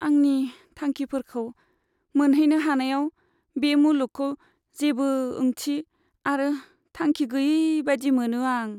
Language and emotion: Bodo, sad